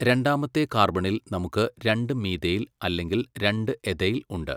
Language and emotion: Malayalam, neutral